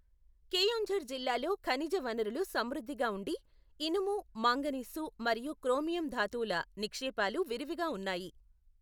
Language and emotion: Telugu, neutral